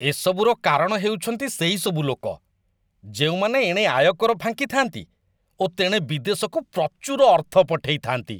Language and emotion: Odia, disgusted